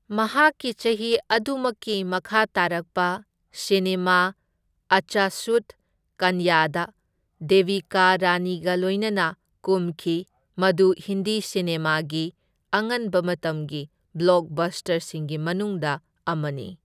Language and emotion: Manipuri, neutral